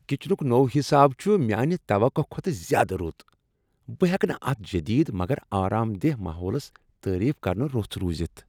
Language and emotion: Kashmiri, happy